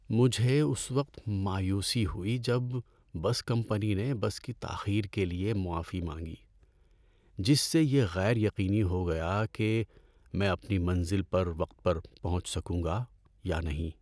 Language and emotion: Urdu, sad